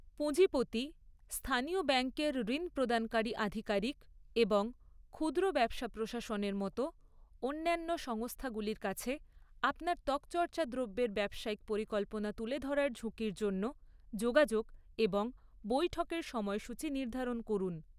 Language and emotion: Bengali, neutral